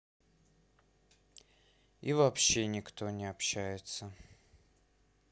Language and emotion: Russian, sad